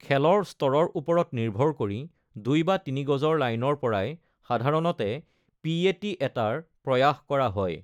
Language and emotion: Assamese, neutral